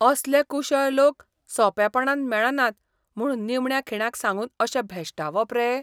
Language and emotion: Goan Konkani, disgusted